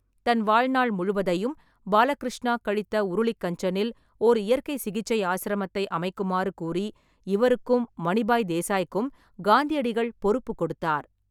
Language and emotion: Tamil, neutral